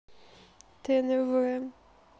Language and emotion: Russian, neutral